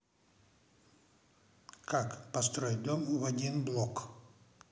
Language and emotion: Russian, neutral